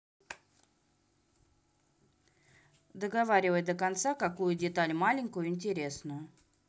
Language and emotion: Russian, neutral